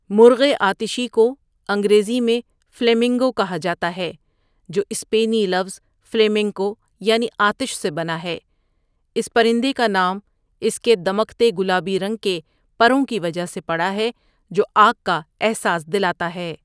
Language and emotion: Urdu, neutral